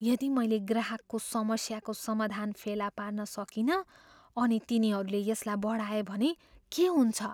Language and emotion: Nepali, fearful